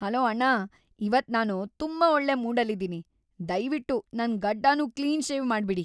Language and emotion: Kannada, happy